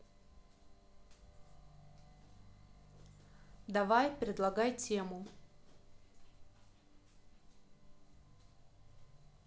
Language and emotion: Russian, neutral